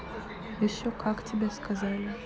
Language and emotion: Russian, neutral